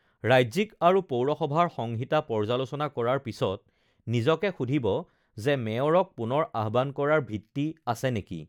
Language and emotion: Assamese, neutral